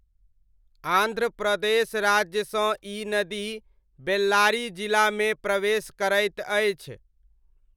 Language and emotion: Maithili, neutral